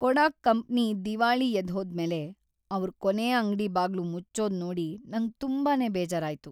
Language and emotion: Kannada, sad